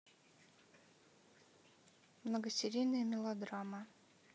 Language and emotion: Russian, neutral